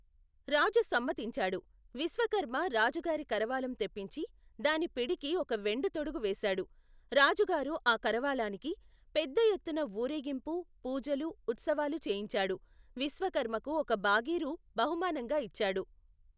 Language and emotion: Telugu, neutral